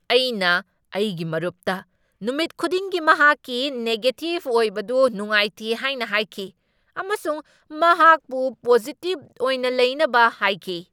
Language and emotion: Manipuri, angry